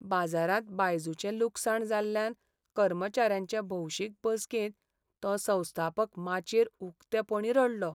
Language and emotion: Goan Konkani, sad